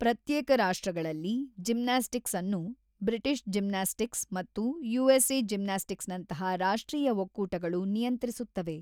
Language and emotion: Kannada, neutral